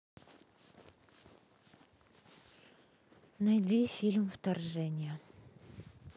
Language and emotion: Russian, neutral